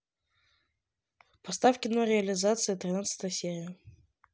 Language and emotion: Russian, neutral